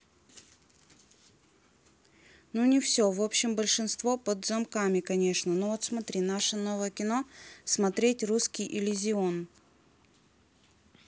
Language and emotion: Russian, neutral